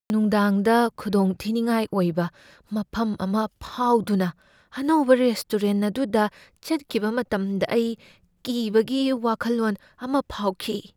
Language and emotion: Manipuri, fearful